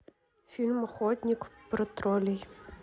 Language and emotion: Russian, neutral